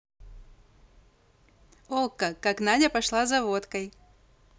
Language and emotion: Russian, positive